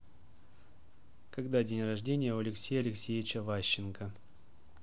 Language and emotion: Russian, neutral